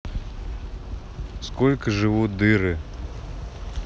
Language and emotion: Russian, neutral